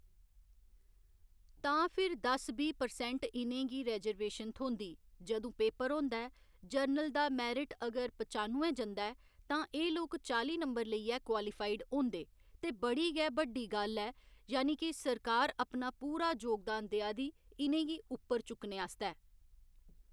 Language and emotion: Dogri, neutral